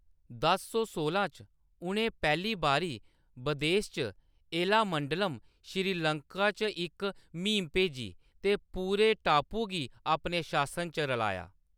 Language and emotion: Dogri, neutral